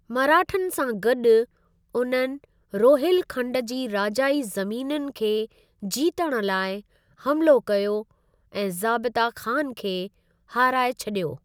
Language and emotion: Sindhi, neutral